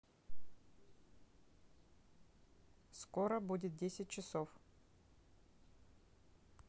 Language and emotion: Russian, neutral